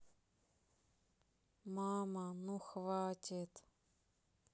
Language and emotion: Russian, sad